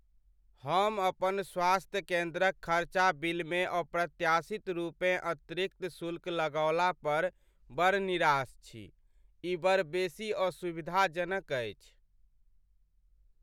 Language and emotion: Maithili, sad